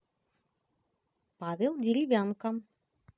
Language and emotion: Russian, positive